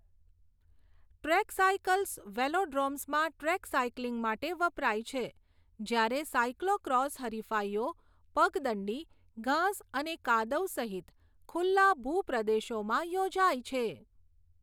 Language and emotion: Gujarati, neutral